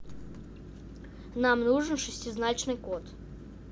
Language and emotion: Russian, neutral